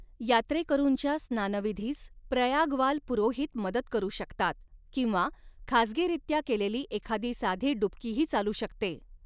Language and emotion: Marathi, neutral